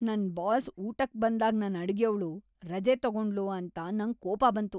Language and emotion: Kannada, angry